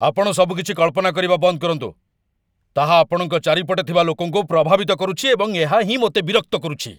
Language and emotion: Odia, angry